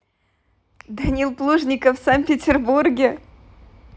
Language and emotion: Russian, positive